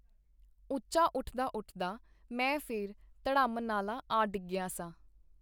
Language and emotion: Punjabi, neutral